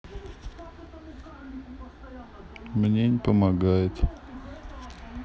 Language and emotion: Russian, sad